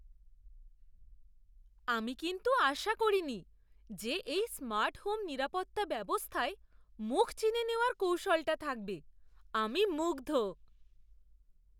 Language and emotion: Bengali, surprised